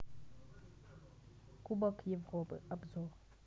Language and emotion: Russian, neutral